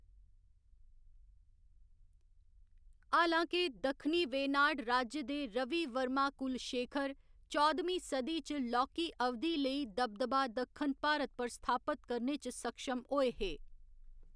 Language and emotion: Dogri, neutral